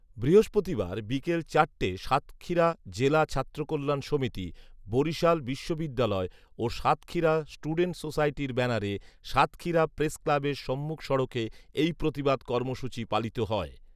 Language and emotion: Bengali, neutral